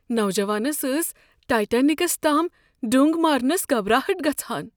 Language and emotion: Kashmiri, fearful